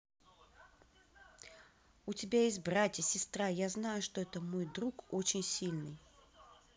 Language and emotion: Russian, neutral